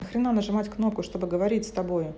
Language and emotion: Russian, angry